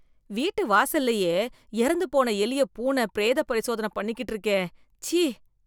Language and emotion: Tamil, disgusted